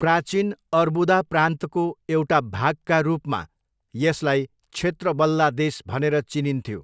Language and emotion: Nepali, neutral